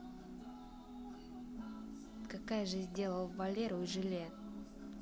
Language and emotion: Russian, neutral